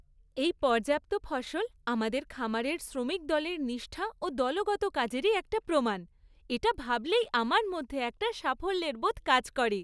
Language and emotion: Bengali, happy